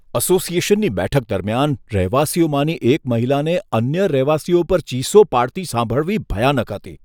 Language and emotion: Gujarati, disgusted